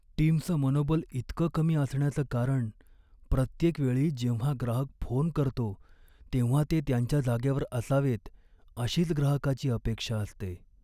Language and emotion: Marathi, sad